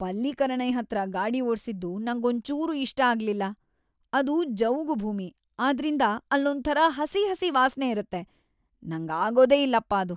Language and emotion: Kannada, disgusted